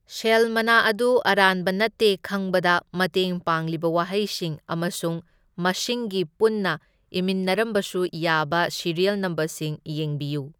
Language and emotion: Manipuri, neutral